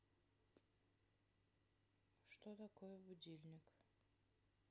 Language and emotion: Russian, sad